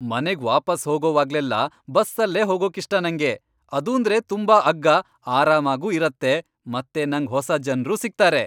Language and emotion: Kannada, happy